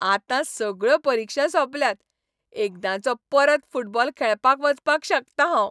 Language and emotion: Goan Konkani, happy